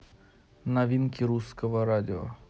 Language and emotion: Russian, neutral